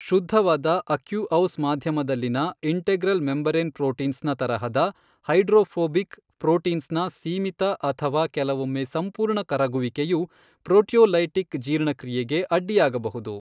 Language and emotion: Kannada, neutral